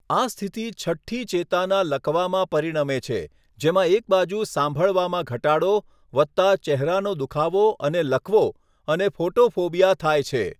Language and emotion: Gujarati, neutral